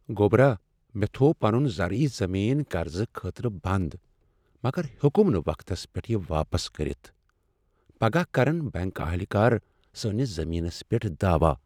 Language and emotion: Kashmiri, sad